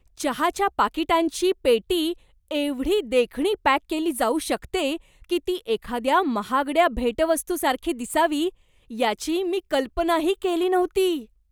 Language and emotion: Marathi, surprised